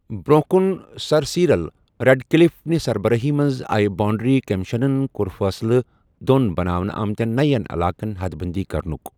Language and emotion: Kashmiri, neutral